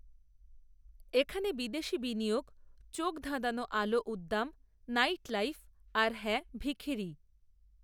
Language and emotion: Bengali, neutral